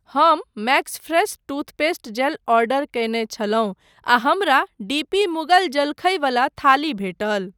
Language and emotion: Maithili, neutral